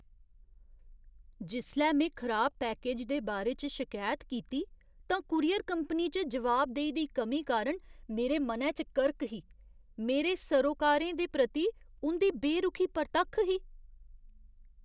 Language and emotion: Dogri, disgusted